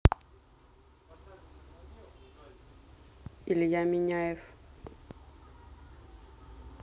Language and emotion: Russian, neutral